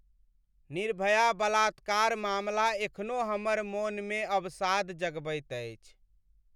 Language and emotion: Maithili, sad